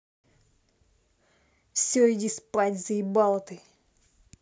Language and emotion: Russian, angry